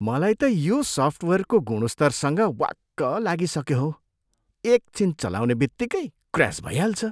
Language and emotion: Nepali, disgusted